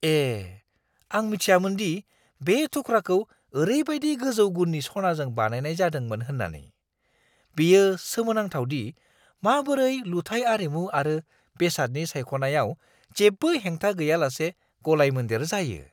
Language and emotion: Bodo, surprised